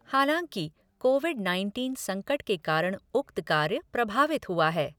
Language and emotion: Hindi, neutral